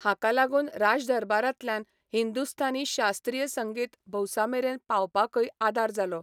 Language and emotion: Goan Konkani, neutral